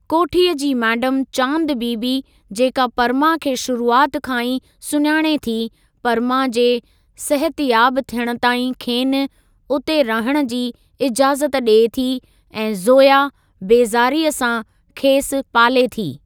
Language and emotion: Sindhi, neutral